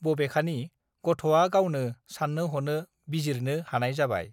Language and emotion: Bodo, neutral